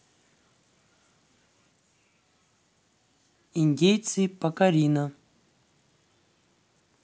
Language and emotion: Russian, neutral